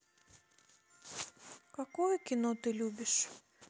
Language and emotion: Russian, sad